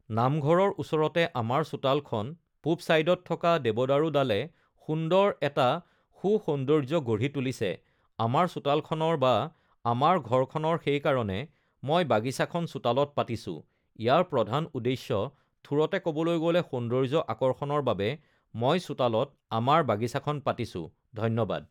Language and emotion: Assamese, neutral